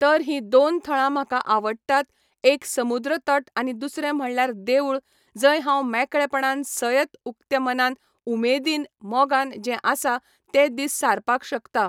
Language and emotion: Goan Konkani, neutral